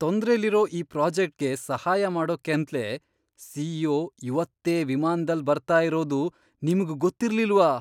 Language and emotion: Kannada, surprised